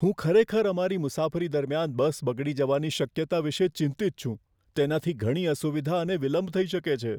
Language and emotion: Gujarati, fearful